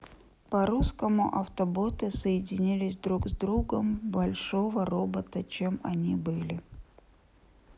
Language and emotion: Russian, neutral